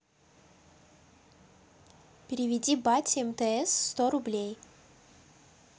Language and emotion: Russian, neutral